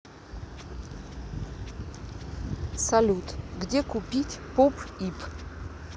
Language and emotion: Russian, neutral